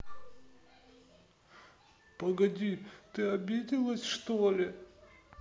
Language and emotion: Russian, sad